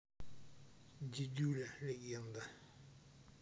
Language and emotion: Russian, neutral